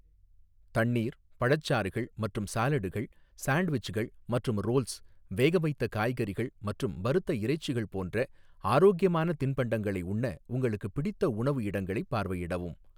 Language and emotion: Tamil, neutral